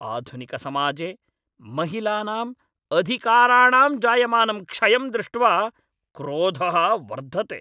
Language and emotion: Sanskrit, angry